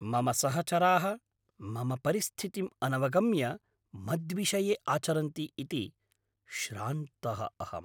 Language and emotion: Sanskrit, angry